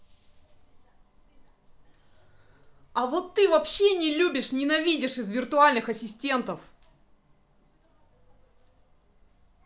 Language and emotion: Russian, angry